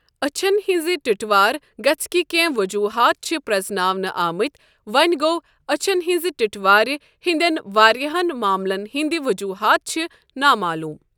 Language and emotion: Kashmiri, neutral